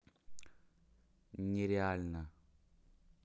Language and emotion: Russian, neutral